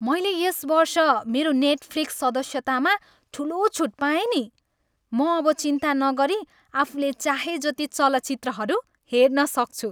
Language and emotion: Nepali, happy